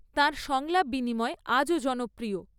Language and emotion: Bengali, neutral